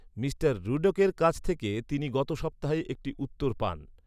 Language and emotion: Bengali, neutral